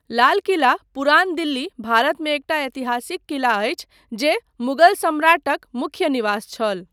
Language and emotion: Maithili, neutral